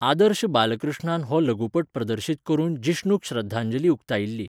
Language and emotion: Goan Konkani, neutral